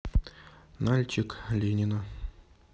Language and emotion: Russian, neutral